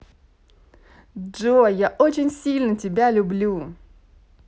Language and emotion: Russian, positive